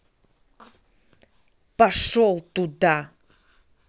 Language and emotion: Russian, angry